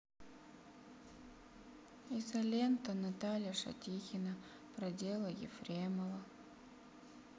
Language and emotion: Russian, sad